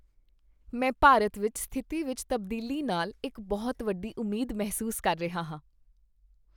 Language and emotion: Punjabi, happy